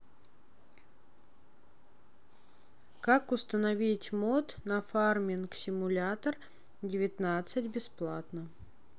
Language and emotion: Russian, neutral